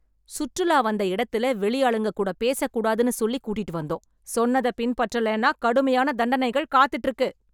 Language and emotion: Tamil, angry